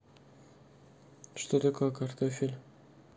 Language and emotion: Russian, neutral